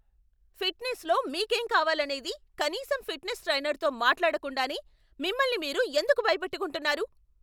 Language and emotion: Telugu, angry